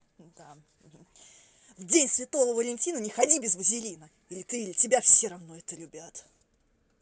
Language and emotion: Russian, angry